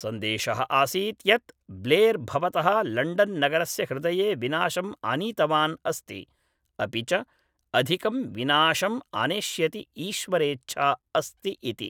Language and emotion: Sanskrit, neutral